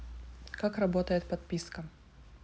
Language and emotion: Russian, neutral